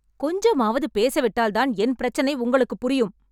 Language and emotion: Tamil, angry